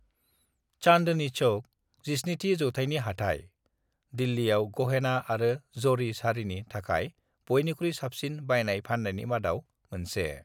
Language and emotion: Bodo, neutral